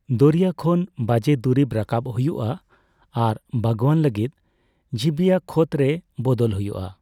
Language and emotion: Santali, neutral